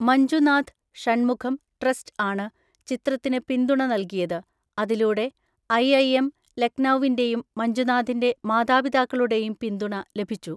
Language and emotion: Malayalam, neutral